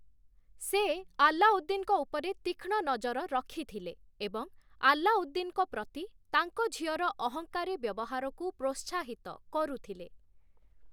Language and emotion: Odia, neutral